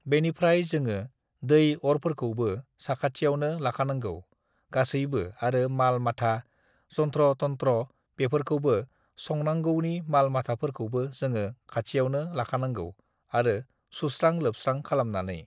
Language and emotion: Bodo, neutral